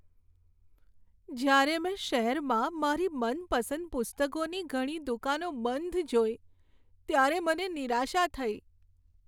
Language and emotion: Gujarati, sad